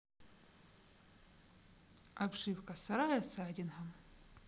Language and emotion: Russian, neutral